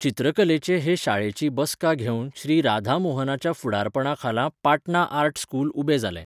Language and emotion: Goan Konkani, neutral